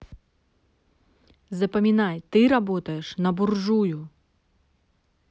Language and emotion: Russian, neutral